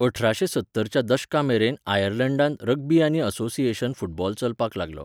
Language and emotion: Goan Konkani, neutral